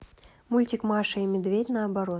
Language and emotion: Russian, neutral